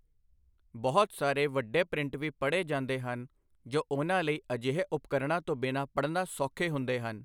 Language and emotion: Punjabi, neutral